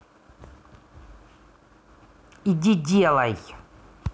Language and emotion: Russian, angry